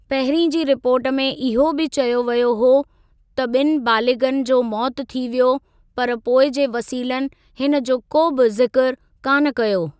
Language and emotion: Sindhi, neutral